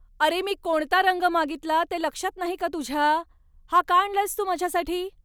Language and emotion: Marathi, angry